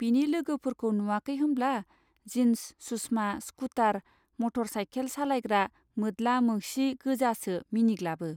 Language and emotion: Bodo, neutral